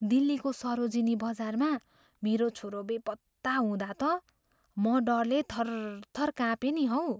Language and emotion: Nepali, fearful